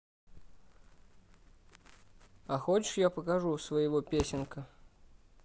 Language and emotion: Russian, neutral